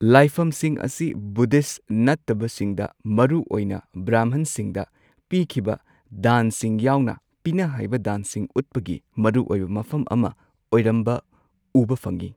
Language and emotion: Manipuri, neutral